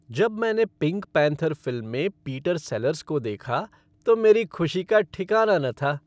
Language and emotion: Hindi, happy